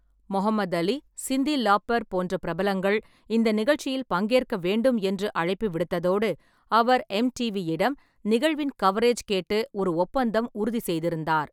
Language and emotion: Tamil, neutral